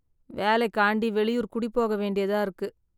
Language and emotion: Tamil, sad